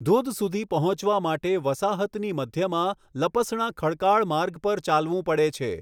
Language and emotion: Gujarati, neutral